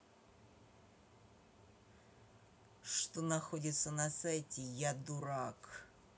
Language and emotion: Russian, angry